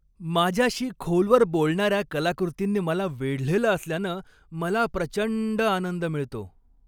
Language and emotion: Marathi, happy